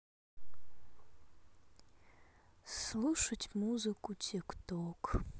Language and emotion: Russian, sad